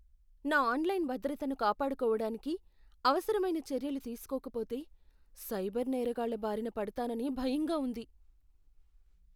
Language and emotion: Telugu, fearful